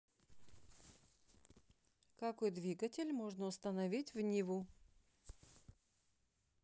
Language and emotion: Russian, neutral